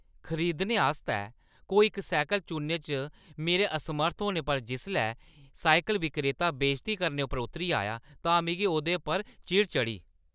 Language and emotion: Dogri, angry